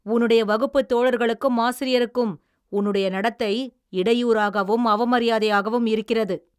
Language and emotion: Tamil, angry